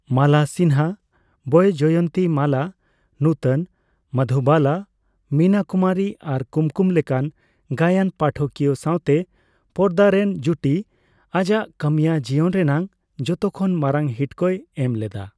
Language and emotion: Santali, neutral